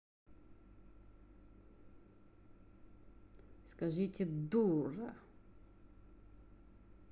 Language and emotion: Russian, angry